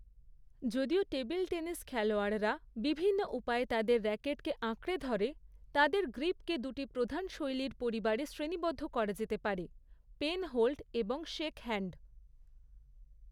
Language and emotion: Bengali, neutral